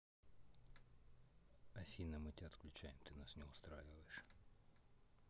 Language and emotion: Russian, neutral